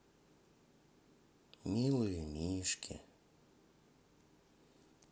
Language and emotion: Russian, sad